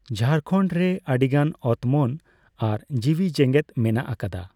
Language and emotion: Santali, neutral